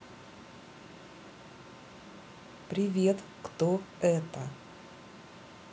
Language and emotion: Russian, neutral